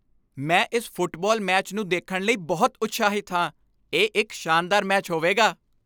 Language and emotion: Punjabi, happy